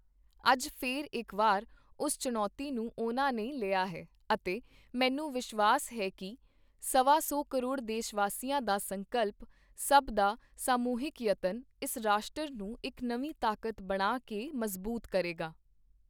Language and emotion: Punjabi, neutral